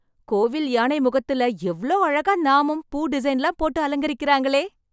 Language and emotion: Tamil, happy